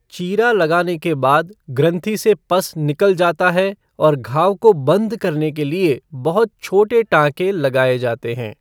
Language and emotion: Hindi, neutral